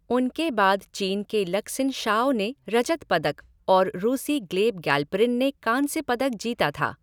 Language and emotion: Hindi, neutral